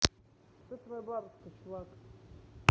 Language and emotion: Russian, neutral